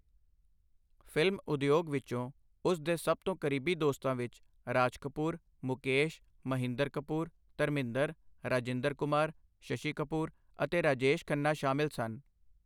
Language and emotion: Punjabi, neutral